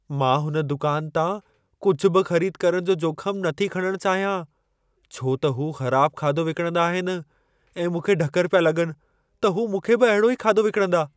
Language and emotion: Sindhi, fearful